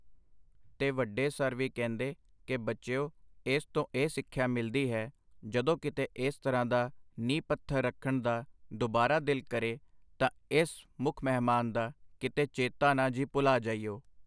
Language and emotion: Punjabi, neutral